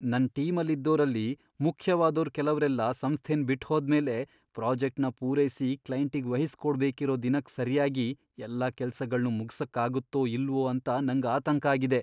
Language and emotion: Kannada, fearful